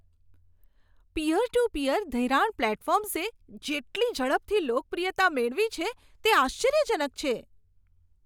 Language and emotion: Gujarati, surprised